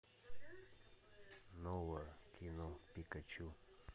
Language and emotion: Russian, neutral